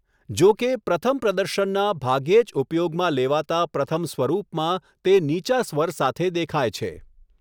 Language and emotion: Gujarati, neutral